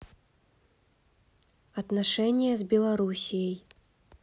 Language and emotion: Russian, neutral